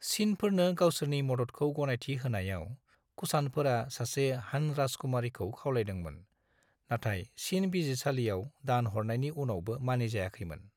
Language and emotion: Bodo, neutral